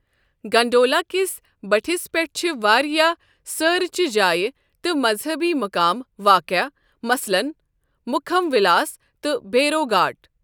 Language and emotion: Kashmiri, neutral